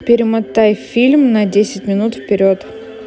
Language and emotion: Russian, neutral